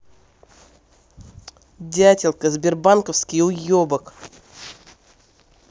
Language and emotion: Russian, angry